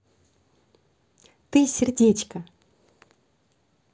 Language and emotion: Russian, positive